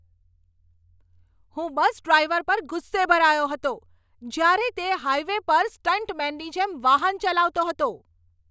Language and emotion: Gujarati, angry